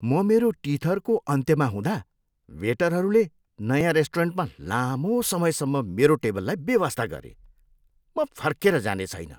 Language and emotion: Nepali, disgusted